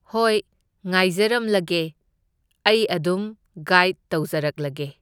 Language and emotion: Manipuri, neutral